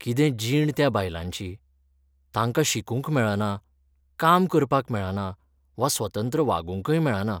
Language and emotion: Goan Konkani, sad